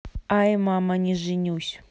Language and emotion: Russian, neutral